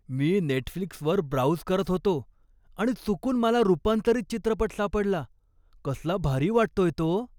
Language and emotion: Marathi, surprised